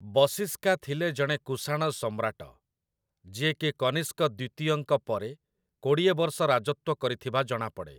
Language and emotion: Odia, neutral